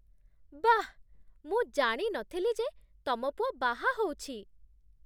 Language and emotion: Odia, surprised